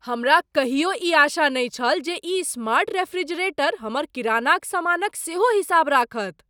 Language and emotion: Maithili, surprised